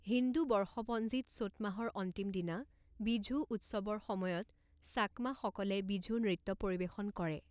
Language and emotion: Assamese, neutral